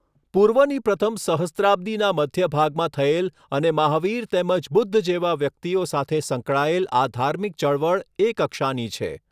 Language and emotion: Gujarati, neutral